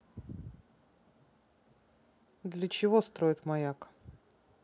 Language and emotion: Russian, neutral